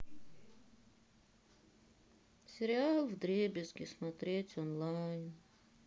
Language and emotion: Russian, sad